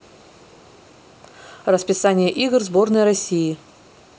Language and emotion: Russian, neutral